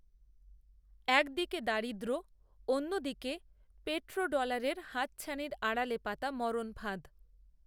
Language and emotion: Bengali, neutral